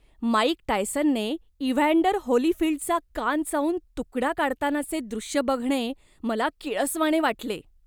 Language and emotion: Marathi, disgusted